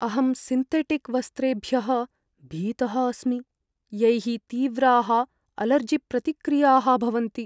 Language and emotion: Sanskrit, fearful